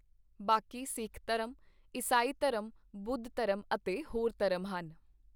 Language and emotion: Punjabi, neutral